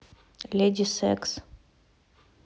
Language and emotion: Russian, neutral